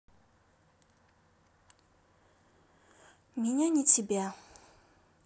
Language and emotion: Russian, sad